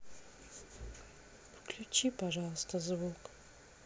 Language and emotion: Russian, sad